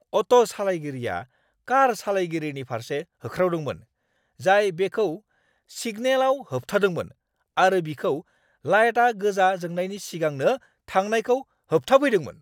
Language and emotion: Bodo, angry